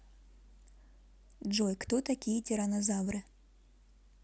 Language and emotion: Russian, neutral